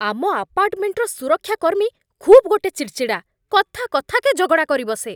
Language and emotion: Odia, angry